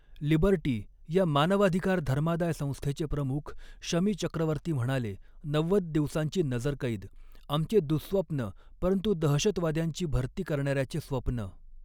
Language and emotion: Marathi, neutral